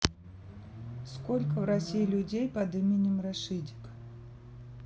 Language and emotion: Russian, neutral